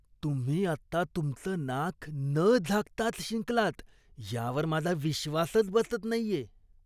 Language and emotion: Marathi, disgusted